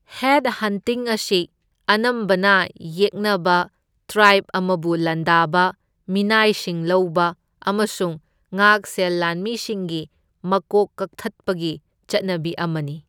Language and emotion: Manipuri, neutral